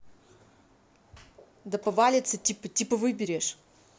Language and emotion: Russian, angry